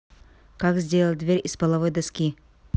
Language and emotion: Russian, neutral